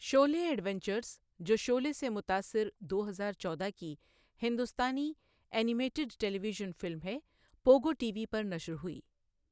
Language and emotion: Urdu, neutral